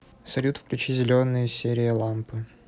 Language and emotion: Russian, neutral